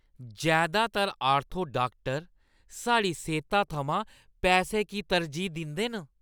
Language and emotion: Dogri, disgusted